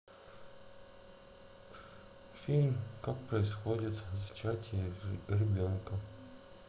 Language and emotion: Russian, sad